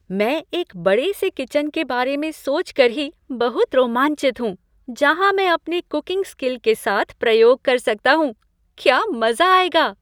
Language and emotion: Hindi, happy